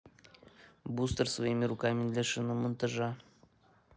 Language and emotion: Russian, neutral